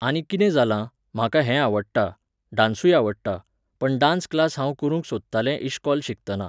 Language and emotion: Goan Konkani, neutral